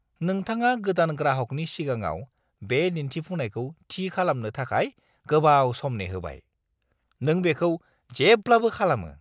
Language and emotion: Bodo, disgusted